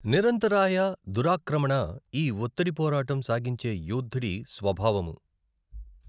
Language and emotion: Telugu, neutral